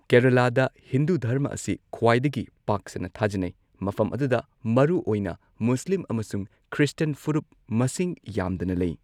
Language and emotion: Manipuri, neutral